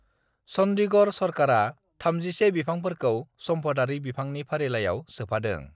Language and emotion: Bodo, neutral